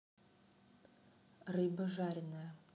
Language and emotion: Russian, neutral